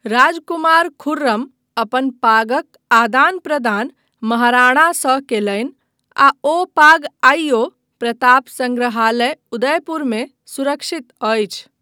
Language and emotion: Maithili, neutral